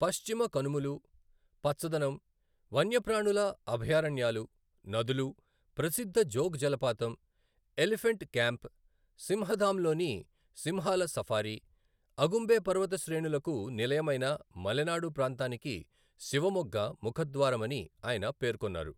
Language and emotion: Telugu, neutral